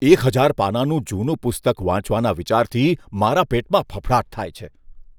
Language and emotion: Gujarati, disgusted